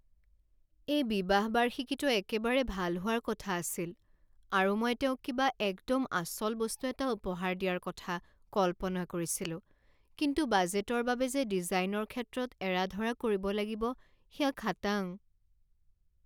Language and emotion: Assamese, sad